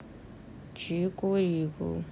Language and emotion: Russian, neutral